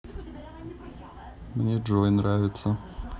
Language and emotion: Russian, neutral